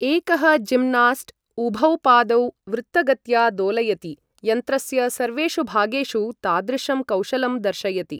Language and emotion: Sanskrit, neutral